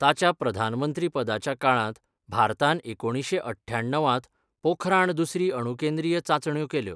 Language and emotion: Goan Konkani, neutral